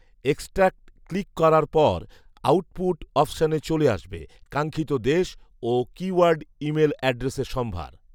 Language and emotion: Bengali, neutral